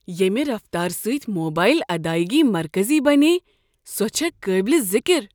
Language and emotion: Kashmiri, surprised